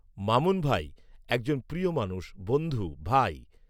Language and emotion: Bengali, neutral